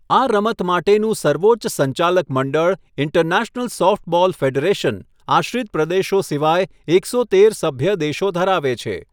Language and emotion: Gujarati, neutral